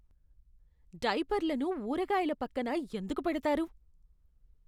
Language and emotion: Telugu, disgusted